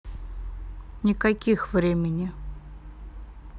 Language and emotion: Russian, neutral